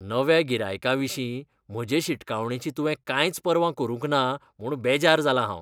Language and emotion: Goan Konkani, disgusted